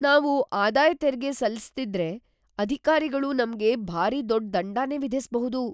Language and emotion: Kannada, fearful